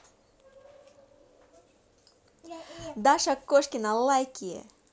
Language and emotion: Russian, positive